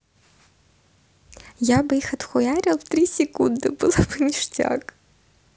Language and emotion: Russian, positive